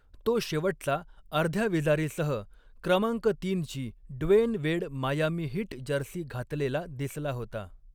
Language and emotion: Marathi, neutral